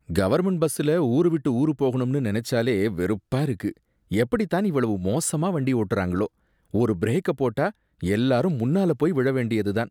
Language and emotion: Tamil, disgusted